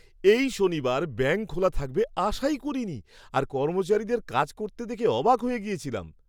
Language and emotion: Bengali, surprised